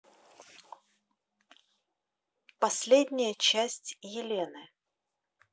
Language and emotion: Russian, neutral